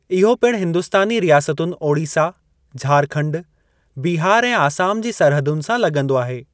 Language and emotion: Sindhi, neutral